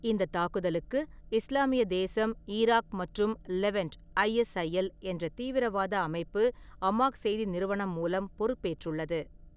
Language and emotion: Tamil, neutral